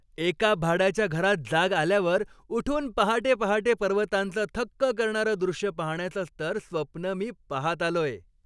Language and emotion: Marathi, happy